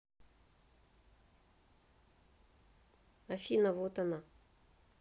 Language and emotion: Russian, neutral